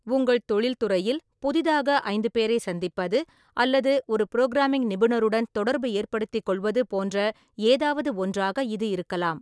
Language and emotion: Tamil, neutral